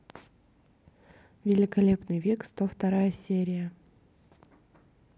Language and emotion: Russian, neutral